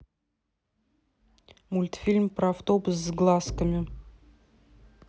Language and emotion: Russian, neutral